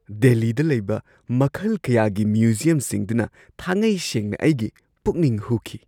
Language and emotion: Manipuri, surprised